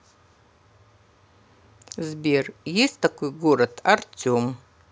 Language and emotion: Russian, neutral